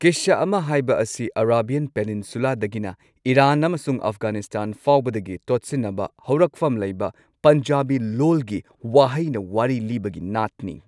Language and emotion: Manipuri, neutral